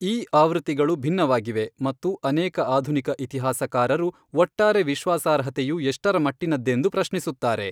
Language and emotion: Kannada, neutral